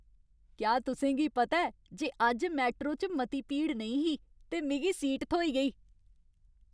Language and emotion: Dogri, happy